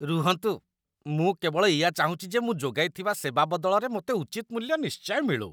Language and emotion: Odia, disgusted